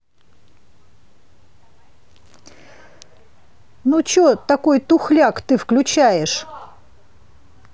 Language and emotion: Russian, angry